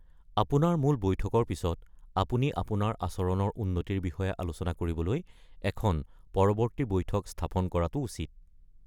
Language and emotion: Assamese, neutral